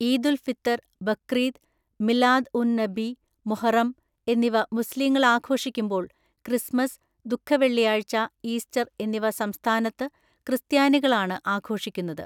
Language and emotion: Malayalam, neutral